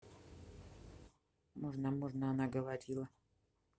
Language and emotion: Russian, neutral